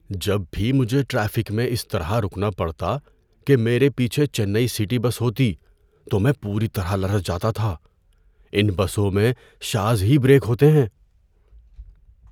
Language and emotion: Urdu, fearful